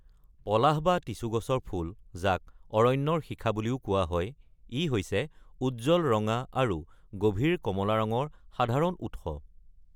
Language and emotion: Assamese, neutral